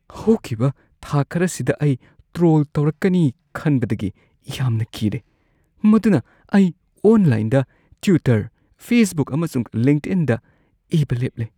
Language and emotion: Manipuri, fearful